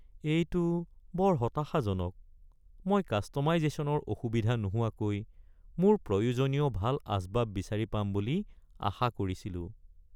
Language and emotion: Assamese, sad